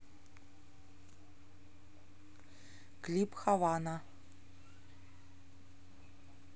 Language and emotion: Russian, neutral